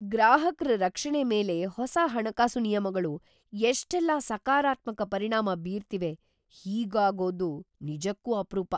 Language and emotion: Kannada, surprised